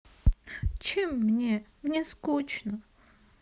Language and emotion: Russian, sad